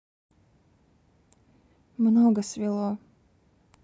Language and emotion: Russian, neutral